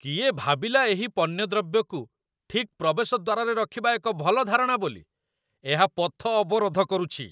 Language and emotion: Odia, disgusted